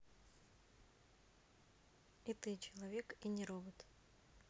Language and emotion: Russian, neutral